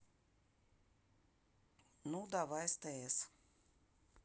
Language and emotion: Russian, neutral